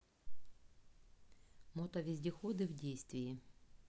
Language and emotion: Russian, neutral